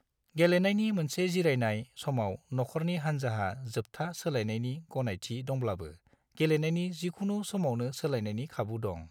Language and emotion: Bodo, neutral